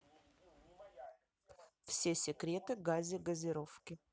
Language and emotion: Russian, neutral